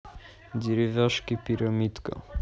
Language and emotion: Russian, neutral